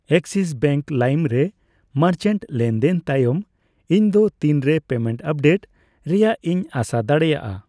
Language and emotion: Santali, neutral